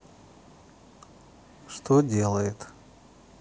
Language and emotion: Russian, neutral